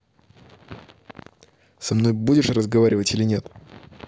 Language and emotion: Russian, angry